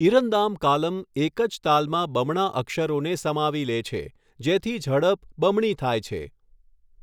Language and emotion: Gujarati, neutral